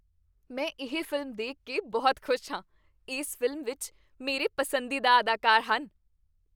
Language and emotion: Punjabi, happy